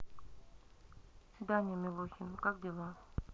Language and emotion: Russian, neutral